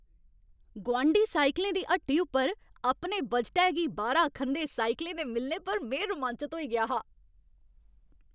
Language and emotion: Dogri, happy